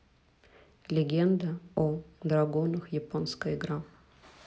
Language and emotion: Russian, neutral